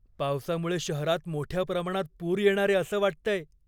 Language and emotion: Marathi, fearful